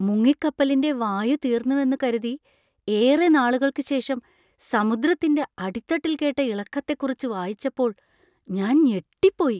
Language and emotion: Malayalam, surprised